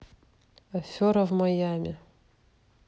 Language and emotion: Russian, neutral